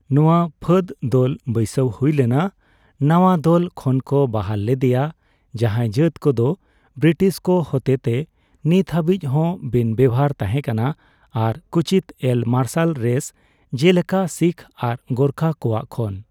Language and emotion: Santali, neutral